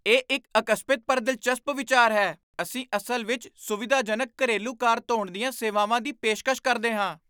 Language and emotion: Punjabi, surprised